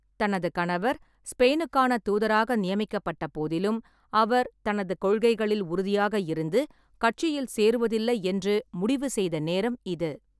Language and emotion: Tamil, neutral